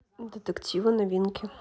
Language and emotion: Russian, neutral